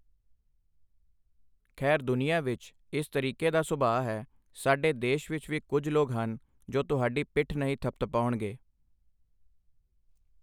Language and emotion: Punjabi, neutral